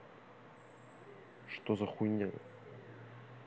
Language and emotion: Russian, angry